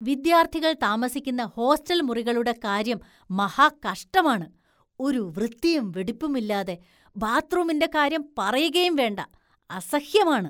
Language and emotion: Malayalam, disgusted